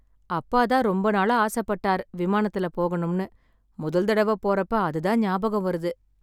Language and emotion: Tamil, sad